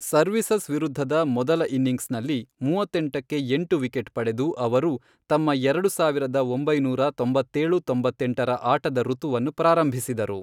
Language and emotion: Kannada, neutral